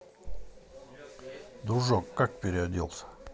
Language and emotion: Russian, neutral